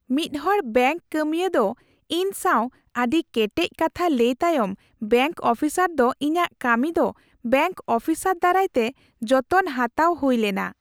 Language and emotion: Santali, happy